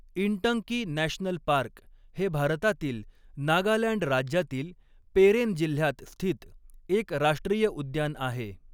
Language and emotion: Marathi, neutral